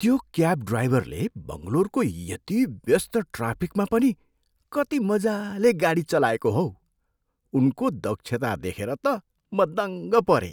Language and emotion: Nepali, surprised